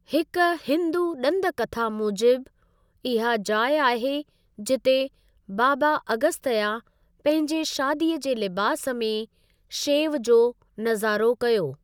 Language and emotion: Sindhi, neutral